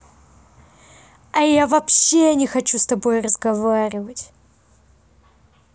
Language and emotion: Russian, angry